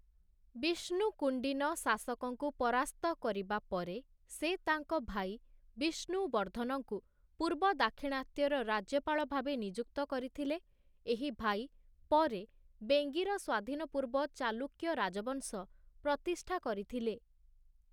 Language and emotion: Odia, neutral